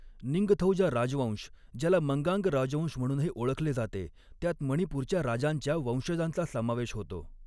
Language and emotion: Marathi, neutral